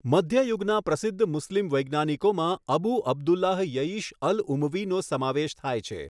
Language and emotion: Gujarati, neutral